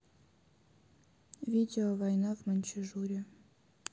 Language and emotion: Russian, neutral